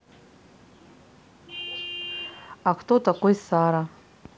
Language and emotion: Russian, neutral